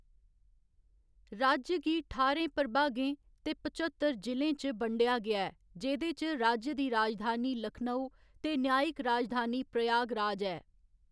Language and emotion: Dogri, neutral